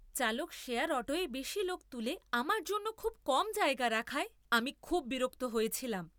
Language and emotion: Bengali, angry